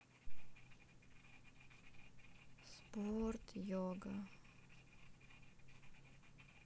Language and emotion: Russian, sad